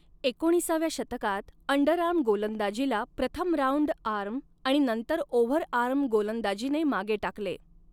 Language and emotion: Marathi, neutral